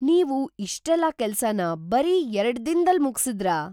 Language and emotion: Kannada, surprised